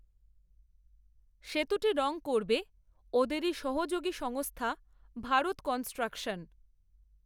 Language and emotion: Bengali, neutral